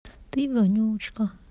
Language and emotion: Russian, sad